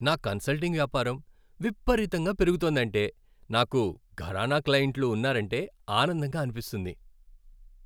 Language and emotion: Telugu, happy